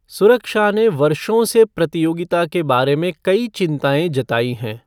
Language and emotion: Hindi, neutral